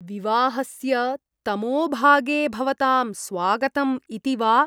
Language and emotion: Sanskrit, disgusted